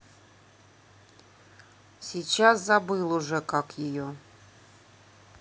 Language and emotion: Russian, neutral